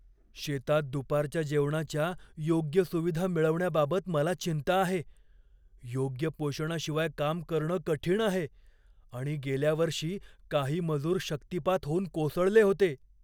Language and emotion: Marathi, fearful